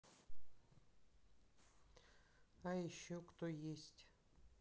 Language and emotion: Russian, neutral